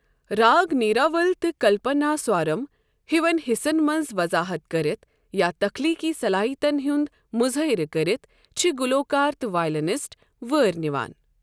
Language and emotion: Kashmiri, neutral